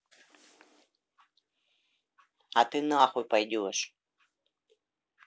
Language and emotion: Russian, angry